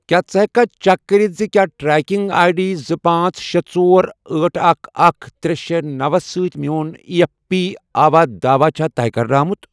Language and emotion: Kashmiri, neutral